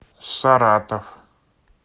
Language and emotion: Russian, neutral